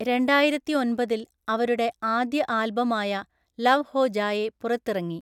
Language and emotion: Malayalam, neutral